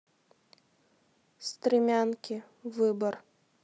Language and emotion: Russian, neutral